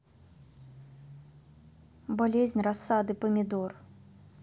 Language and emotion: Russian, neutral